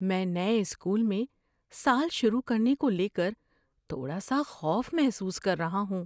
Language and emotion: Urdu, fearful